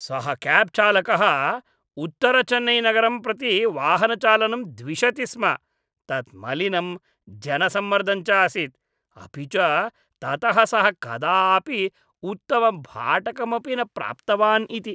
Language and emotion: Sanskrit, disgusted